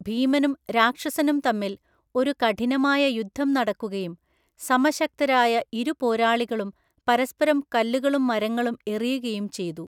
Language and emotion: Malayalam, neutral